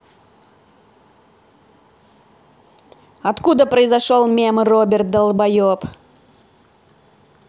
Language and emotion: Russian, angry